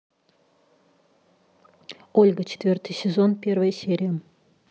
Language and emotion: Russian, neutral